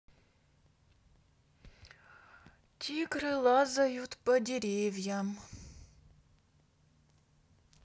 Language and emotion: Russian, sad